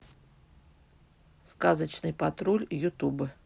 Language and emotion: Russian, neutral